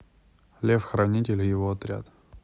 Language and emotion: Russian, neutral